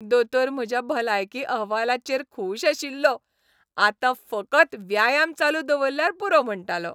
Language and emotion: Goan Konkani, happy